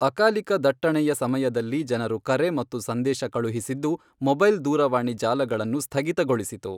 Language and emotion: Kannada, neutral